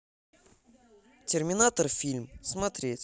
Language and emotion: Russian, neutral